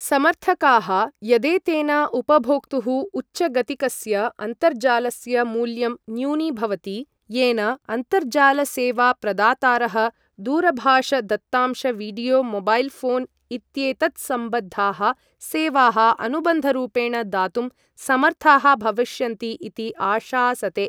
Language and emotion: Sanskrit, neutral